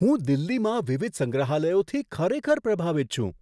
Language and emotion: Gujarati, surprised